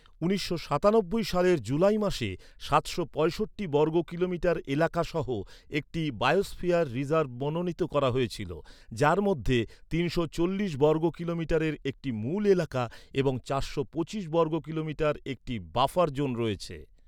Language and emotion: Bengali, neutral